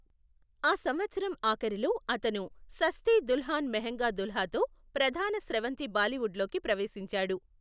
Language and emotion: Telugu, neutral